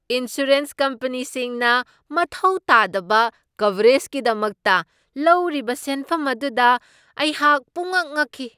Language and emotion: Manipuri, surprised